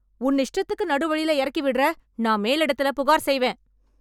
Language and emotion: Tamil, angry